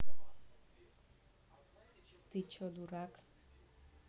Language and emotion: Russian, neutral